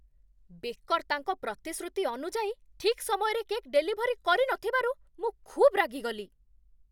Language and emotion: Odia, angry